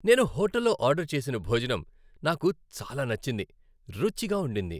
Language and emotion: Telugu, happy